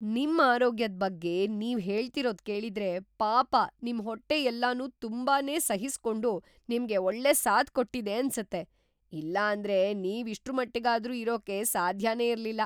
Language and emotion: Kannada, surprised